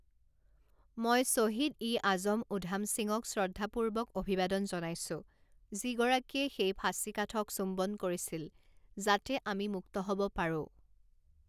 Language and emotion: Assamese, neutral